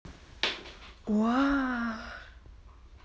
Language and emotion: Russian, positive